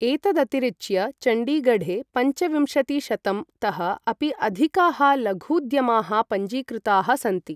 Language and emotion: Sanskrit, neutral